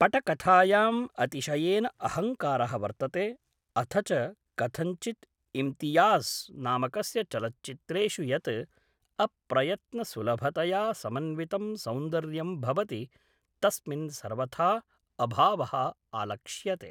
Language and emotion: Sanskrit, neutral